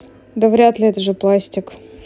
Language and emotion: Russian, neutral